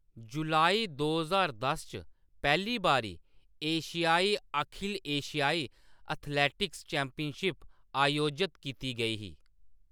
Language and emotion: Dogri, neutral